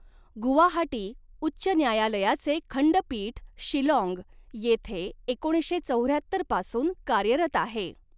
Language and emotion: Marathi, neutral